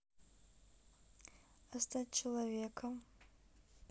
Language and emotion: Russian, neutral